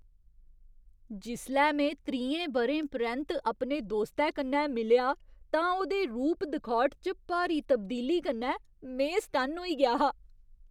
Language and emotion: Dogri, surprised